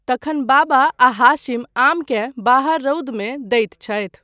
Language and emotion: Maithili, neutral